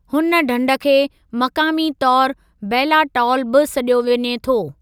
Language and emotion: Sindhi, neutral